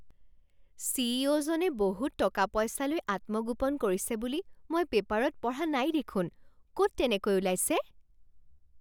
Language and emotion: Assamese, surprised